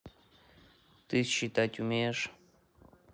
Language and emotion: Russian, neutral